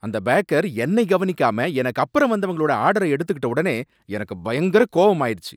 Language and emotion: Tamil, angry